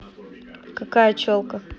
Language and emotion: Russian, neutral